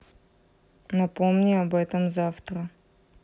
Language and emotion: Russian, neutral